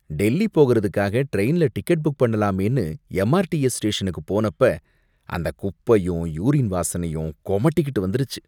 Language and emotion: Tamil, disgusted